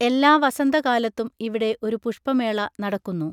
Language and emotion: Malayalam, neutral